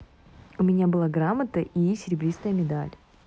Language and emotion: Russian, positive